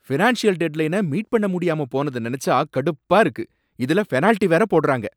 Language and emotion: Tamil, angry